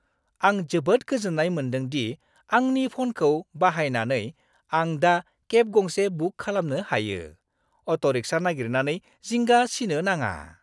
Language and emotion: Bodo, happy